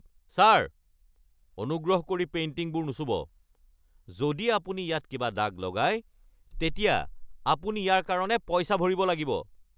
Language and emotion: Assamese, angry